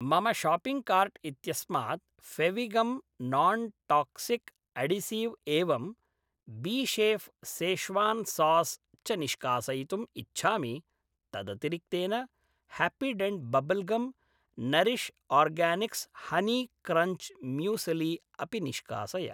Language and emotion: Sanskrit, neutral